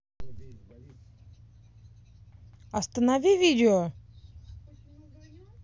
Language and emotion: Russian, angry